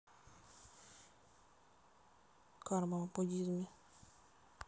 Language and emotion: Russian, neutral